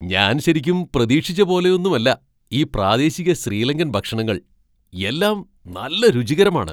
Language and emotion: Malayalam, surprised